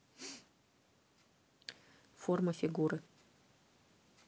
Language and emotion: Russian, neutral